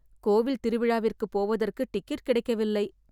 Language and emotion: Tamil, sad